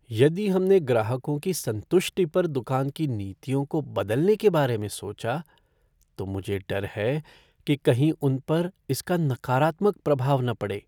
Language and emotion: Hindi, fearful